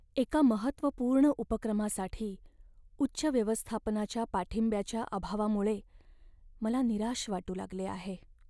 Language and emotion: Marathi, sad